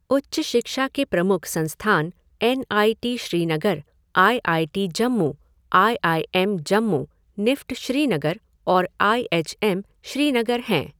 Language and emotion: Hindi, neutral